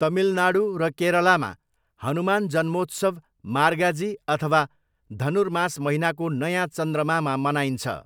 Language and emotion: Nepali, neutral